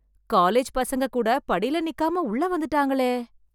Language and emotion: Tamil, surprised